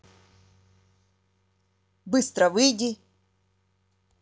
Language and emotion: Russian, angry